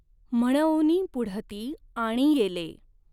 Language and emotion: Marathi, neutral